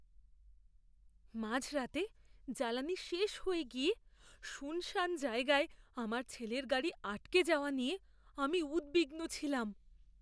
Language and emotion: Bengali, fearful